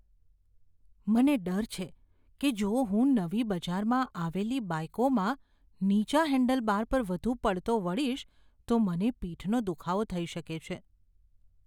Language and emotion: Gujarati, fearful